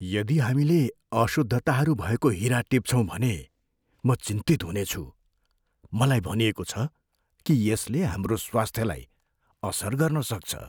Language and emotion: Nepali, fearful